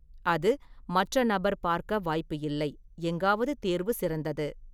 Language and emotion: Tamil, neutral